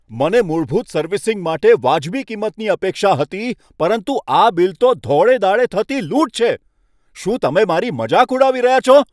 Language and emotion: Gujarati, angry